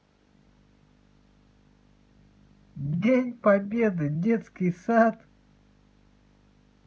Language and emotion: Russian, positive